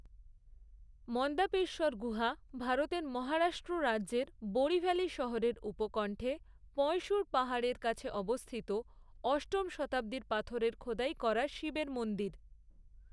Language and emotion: Bengali, neutral